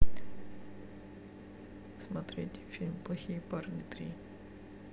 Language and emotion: Russian, sad